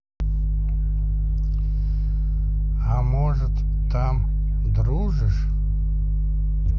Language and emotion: Russian, neutral